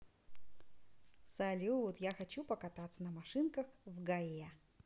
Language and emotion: Russian, positive